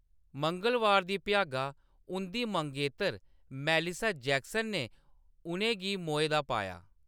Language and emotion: Dogri, neutral